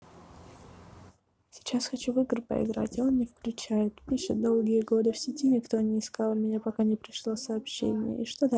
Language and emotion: Russian, sad